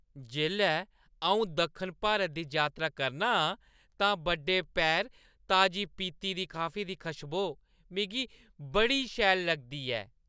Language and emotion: Dogri, happy